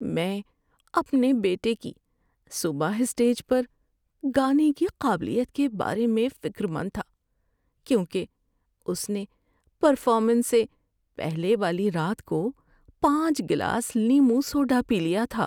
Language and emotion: Urdu, fearful